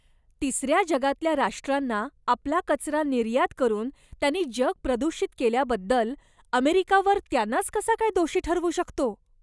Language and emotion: Marathi, disgusted